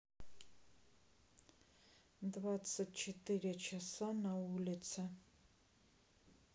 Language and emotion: Russian, neutral